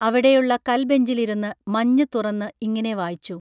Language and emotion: Malayalam, neutral